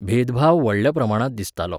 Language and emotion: Goan Konkani, neutral